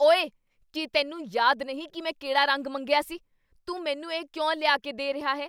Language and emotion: Punjabi, angry